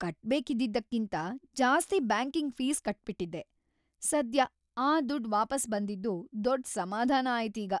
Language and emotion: Kannada, happy